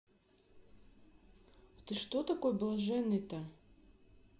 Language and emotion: Russian, neutral